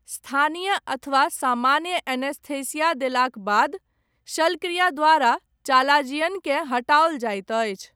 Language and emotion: Maithili, neutral